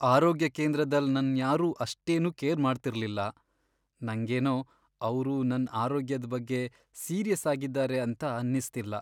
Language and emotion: Kannada, sad